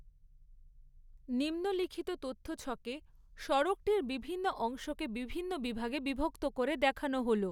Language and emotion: Bengali, neutral